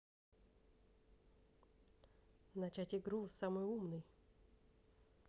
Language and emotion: Russian, neutral